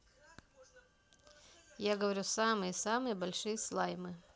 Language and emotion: Russian, neutral